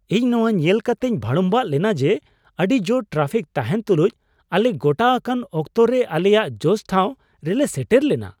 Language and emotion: Santali, surprised